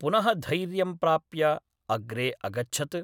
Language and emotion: Sanskrit, neutral